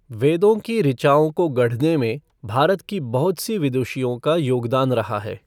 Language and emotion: Hindi, neutral